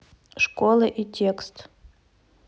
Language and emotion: Russian, neutral